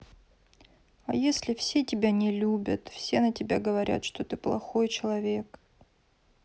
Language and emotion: Russian, sad